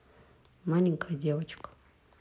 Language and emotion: Russian, neutral